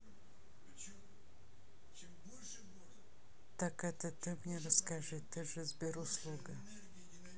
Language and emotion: Russian, neutral